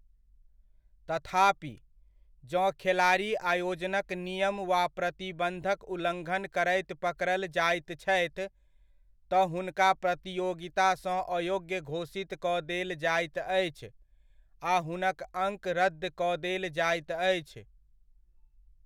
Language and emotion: Maithili, neutral